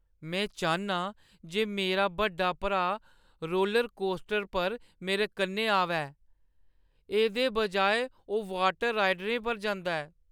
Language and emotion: Dogri, sad